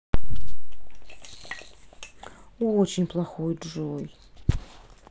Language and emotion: Russian, sad